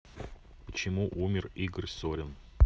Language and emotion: Russian, neutral